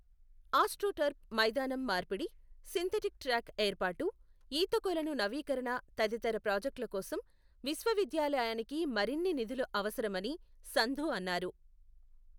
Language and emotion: Telugu, neutral